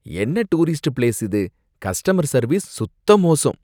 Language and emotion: Tamil, disgusted